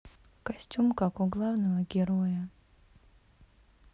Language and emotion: Russian, sad